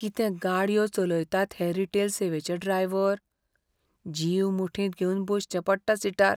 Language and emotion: Goan Konkani, fearful